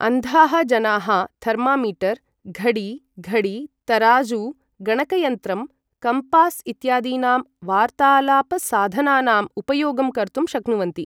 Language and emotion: Sanskrit, neutral